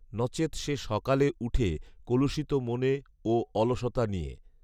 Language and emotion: Bengali, neutral